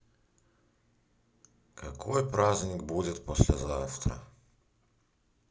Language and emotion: Russian, sad